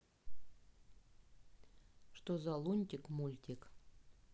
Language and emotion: Russian, neutral